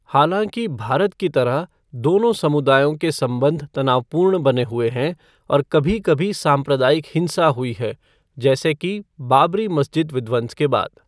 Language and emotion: Hindi, neutral